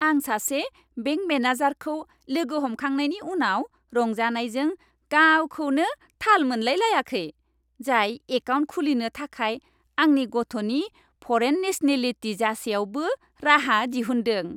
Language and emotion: Bodo, happy